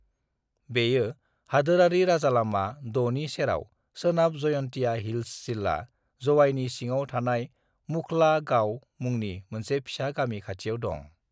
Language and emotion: Bodo, neutral